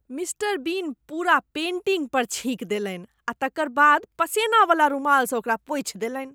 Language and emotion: Maithili, disgusted